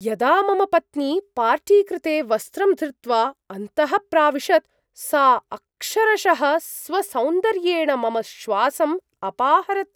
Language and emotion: Sanskrit, surprised